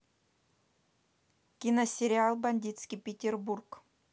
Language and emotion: Russian, neutral